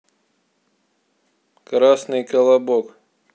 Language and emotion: Russian, neutral